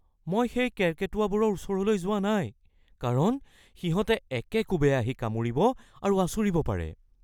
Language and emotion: Assamese, fearful